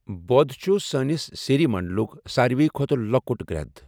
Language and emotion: Kashmiri, neutral